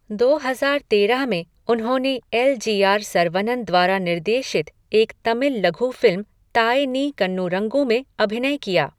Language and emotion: Hindi, neutral